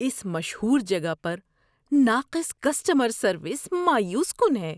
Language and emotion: Urdu, disgusted